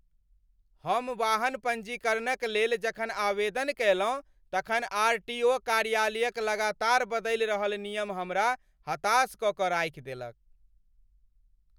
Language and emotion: Maithili, angry